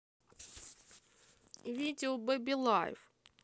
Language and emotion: Russian, neutral